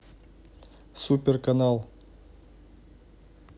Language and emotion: Russian, neutral